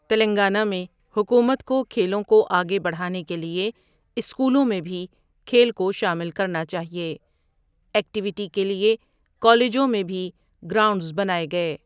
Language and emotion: Urdu, neutral